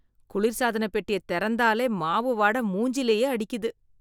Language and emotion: Tamil, disgusted